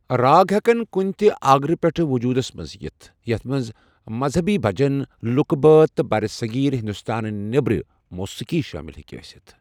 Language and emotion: Kashmiri, neutral